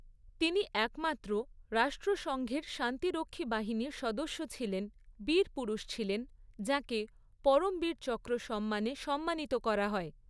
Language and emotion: Bengali, neutral